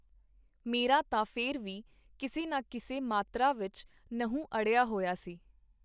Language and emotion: Punjabi, neutral